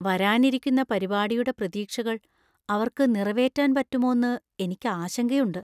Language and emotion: Malayalam, fearful